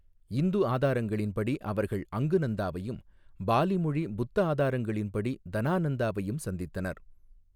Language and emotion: Tamil, neutral